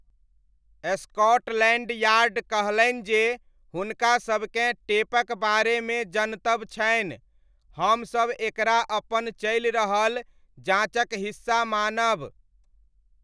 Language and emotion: Maithili, neutral